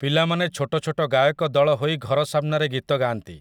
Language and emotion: Odia, neutral